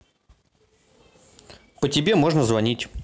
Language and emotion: Russian, neutral